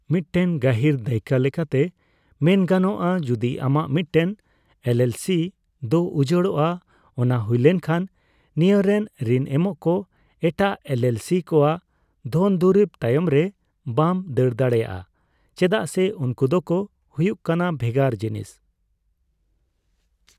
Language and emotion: Santali, neutral